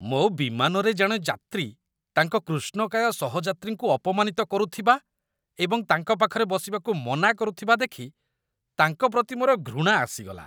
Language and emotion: Odia, disgusted